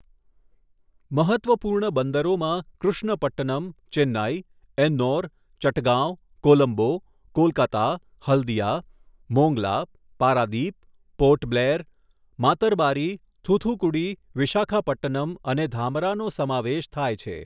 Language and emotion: Gujarati, neutral